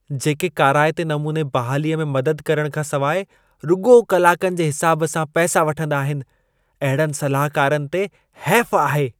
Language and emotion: Sindhi, disgusted